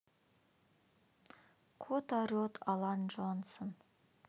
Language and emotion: Russian, neutral